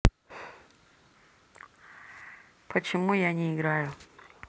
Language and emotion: Russian, neutral